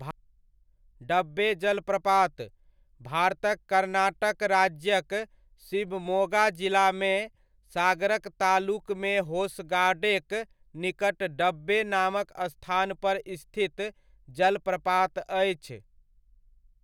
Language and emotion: Maithili, neutral